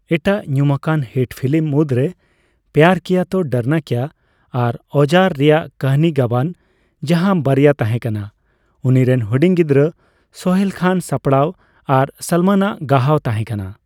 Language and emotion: Santali, neutral